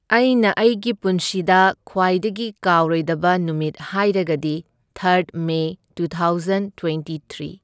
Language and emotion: Manipuri, neutral